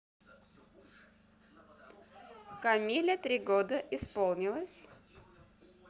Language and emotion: Russian, positive